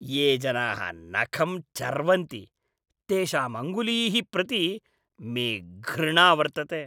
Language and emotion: Sanskrit, disgusted